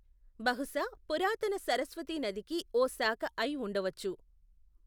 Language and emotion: Telugu, neutral